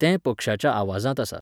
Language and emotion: Goan Konkani, neutral